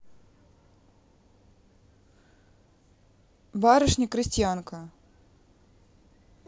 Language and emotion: Russian, neutral